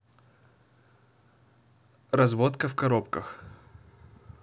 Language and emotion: Russian, neutral